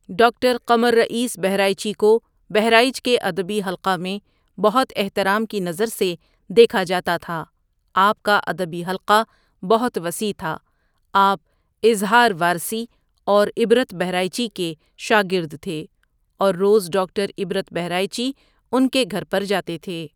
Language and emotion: Urdu, neutral